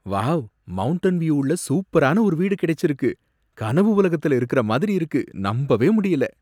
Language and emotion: Tamil, surprised